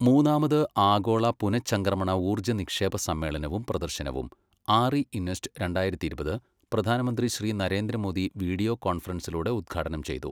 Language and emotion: Malayalam, neutral